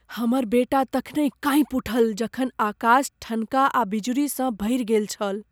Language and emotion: Maithili, fearful